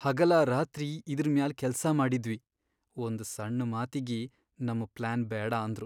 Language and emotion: Kannada, sad